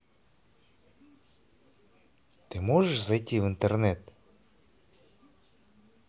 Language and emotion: Russian, angry